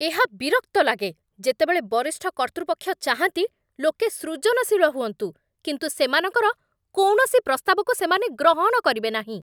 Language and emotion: Odia, angry